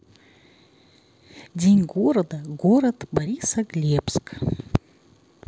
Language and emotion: Russian, neutral